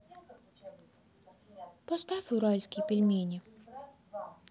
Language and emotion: Russian, sad